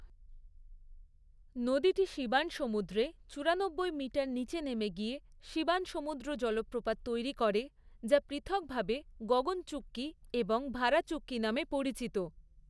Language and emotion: Bengali, neutral